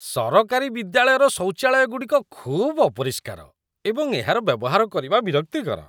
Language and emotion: Odia, disgusted